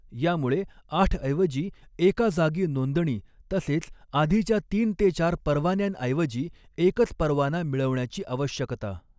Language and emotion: Marathi, neutral